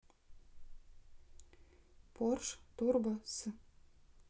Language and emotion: Russian, neutral